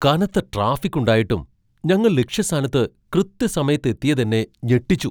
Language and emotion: Malayalam, surprised